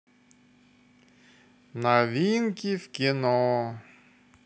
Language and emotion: Russian, positive